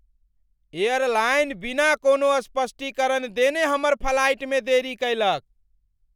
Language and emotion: Maithili, angry